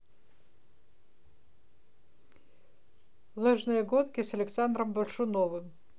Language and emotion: Russian, neutral